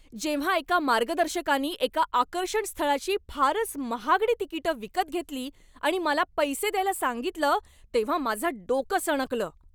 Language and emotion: Marathi, angry